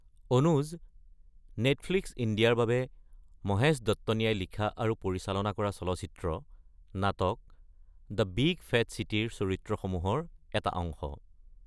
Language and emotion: Assamese, neutral